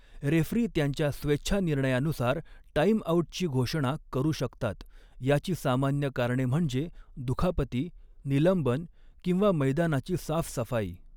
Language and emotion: Marathi, neutral